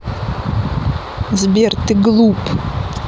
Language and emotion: Russian, angry